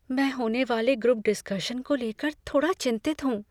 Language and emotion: Hindi, fearful